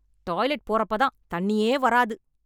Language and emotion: Tamil, angry